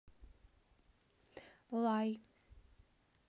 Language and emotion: Russian, neutral